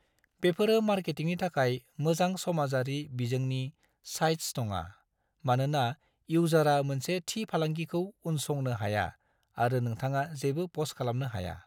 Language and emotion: Bodo, neutral